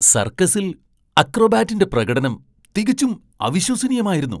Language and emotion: Malayalam, surprised